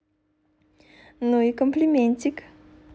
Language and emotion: Russian, positive